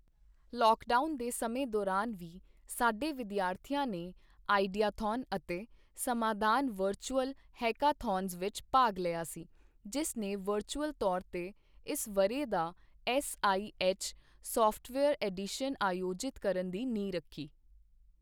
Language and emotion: Punjabi, neutral